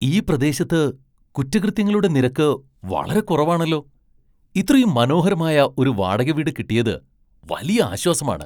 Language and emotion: Malayalam, surprised